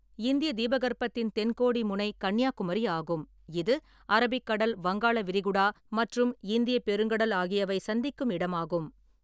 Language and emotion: Tamil, neutral